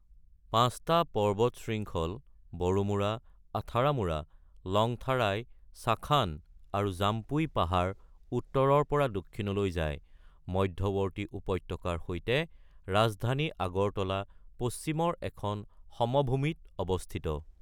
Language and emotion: Assamese, neutral